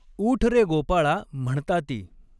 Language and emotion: Marathi, neutral